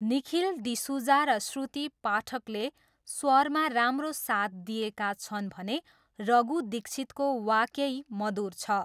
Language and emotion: Nepali, neutral